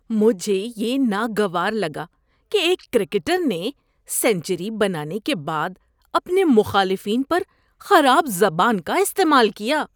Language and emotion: Urdu, disgusted